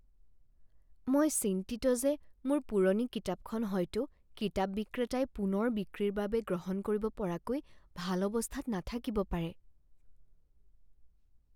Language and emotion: Assamese, fearful